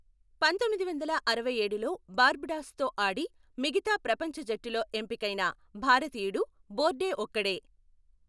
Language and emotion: Telugu, neutral